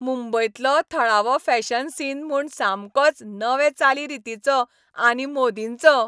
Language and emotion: Goan Konkani, happy